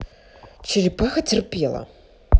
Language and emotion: Russian, neutral